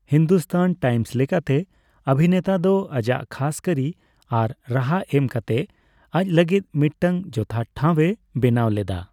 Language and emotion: Santali, neutral